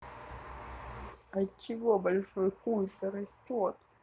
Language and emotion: Russian, sad